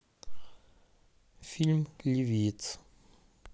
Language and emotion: Russian, neutral